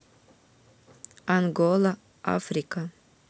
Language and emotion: Russian, neutral